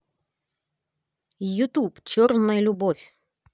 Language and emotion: Russian, positive